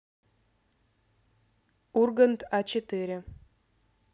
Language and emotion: Russian, neutral